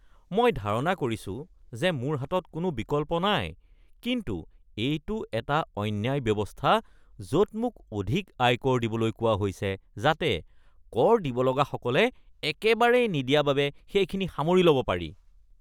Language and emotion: Assamese, disgusted